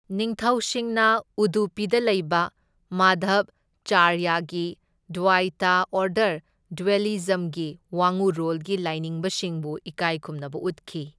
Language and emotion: Manipuri, neutral